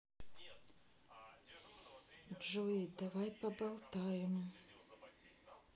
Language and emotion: Russian, sad